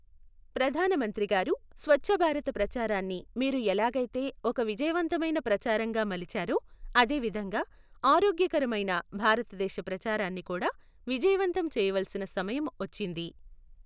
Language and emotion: Telugu, neutral